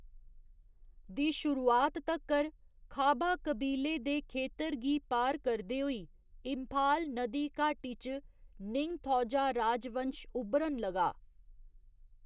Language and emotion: Dogri, neutral